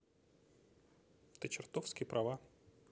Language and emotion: Russian, neutral